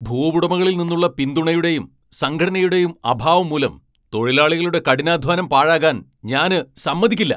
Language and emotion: Malayalam, angry